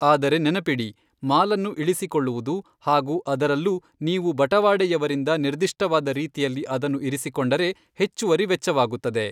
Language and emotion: Kannada, neutral